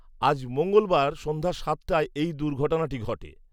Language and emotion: Bengali, neutral